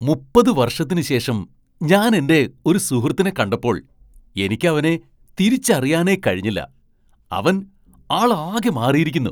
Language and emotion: Malayalam, surprised